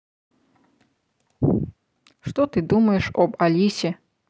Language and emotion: Russian, neutral